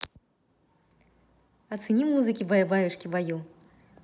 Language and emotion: Russian, positive